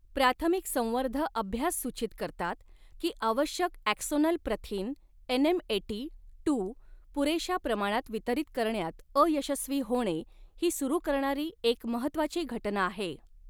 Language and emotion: Marathi, neutral